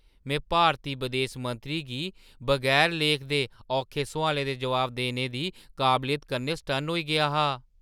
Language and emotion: Dogri, surprised